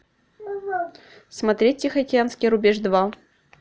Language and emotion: Russian, neutral